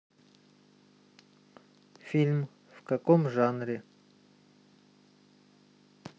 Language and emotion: Russian, neutral